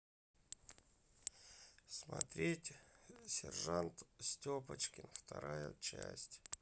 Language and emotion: Russian, sad